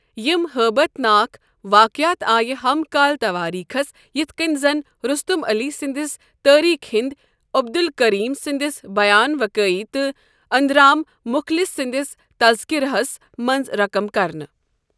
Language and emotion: Kashmiri, neutral